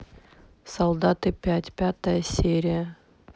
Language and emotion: Russian, neutral